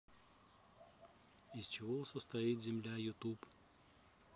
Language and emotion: Russian, neutral